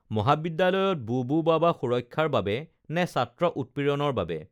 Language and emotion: Assamese, neutral